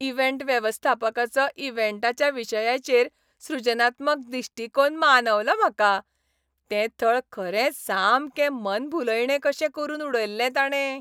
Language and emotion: Goan Konkani, happy